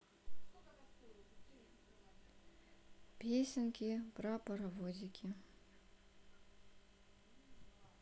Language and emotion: Russian, neutral